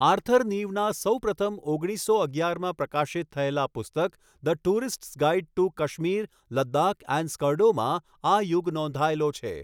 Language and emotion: Gujarati, neutral